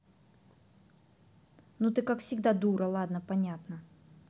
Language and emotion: Russian, angry